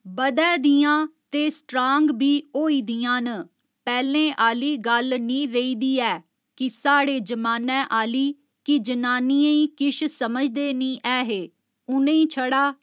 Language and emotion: Dogri, neutral